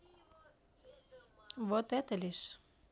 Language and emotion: Russian, neutral